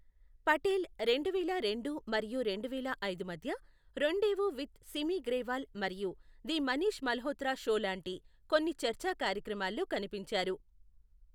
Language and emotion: Telugu, neutral